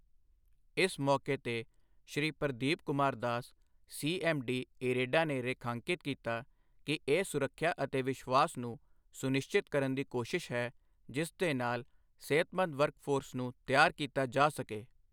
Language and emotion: Punjabi, neutral